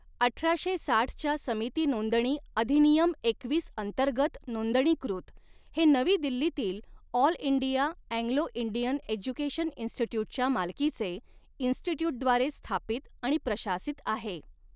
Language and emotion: Marathi, neutral